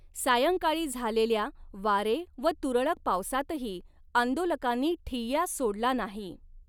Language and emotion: Marathi, neutral